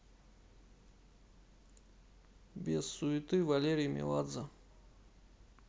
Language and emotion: Russian, neutral